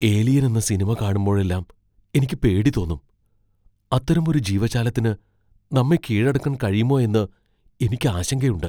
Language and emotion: Malayalam, fearful